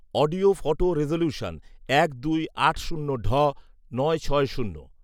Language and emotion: Bengali, neutral